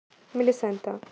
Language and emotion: Russian, neutral